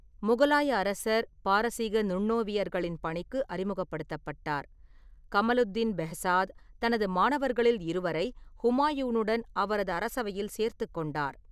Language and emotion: Tamil, neutral